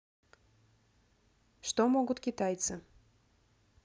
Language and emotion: Russian, neutral